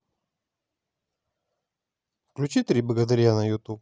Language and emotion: Russian, neutral